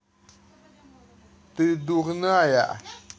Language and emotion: Russian, angry